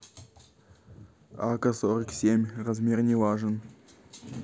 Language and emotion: Russian, neutral